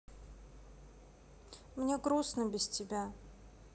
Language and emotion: Russian, sad